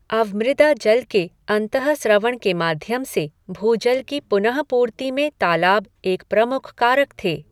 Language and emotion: Hindi, neutral